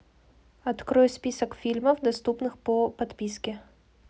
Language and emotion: Russian, neutral